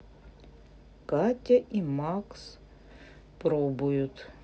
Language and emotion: Russian, neutral